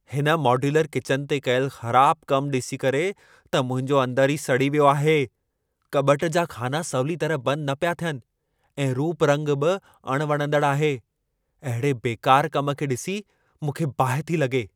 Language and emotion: Sindhi, angry